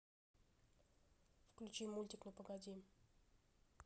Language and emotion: Russian, neutral